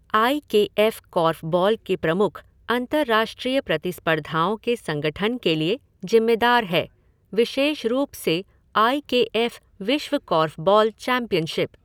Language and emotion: Hindi, neutral